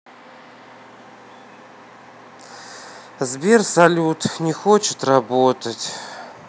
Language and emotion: Russian, sad